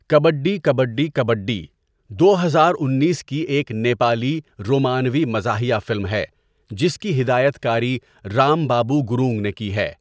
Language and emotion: Urdu, neutral